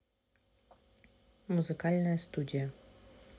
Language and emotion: Russian, neutral